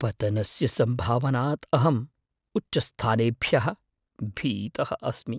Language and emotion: Sanskrit, fearful